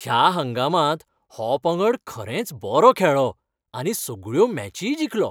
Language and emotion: Goan Konkani, happy